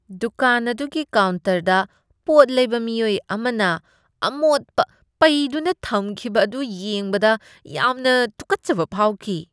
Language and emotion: Manipuri, disgusted